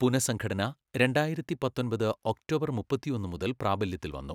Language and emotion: Malayalam, neutral